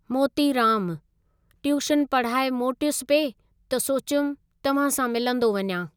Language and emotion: Sindhi, neutral